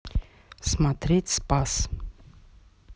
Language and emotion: Russian, neutral